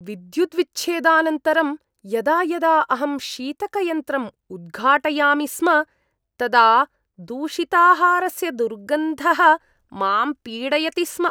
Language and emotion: Sanskrit, disgusted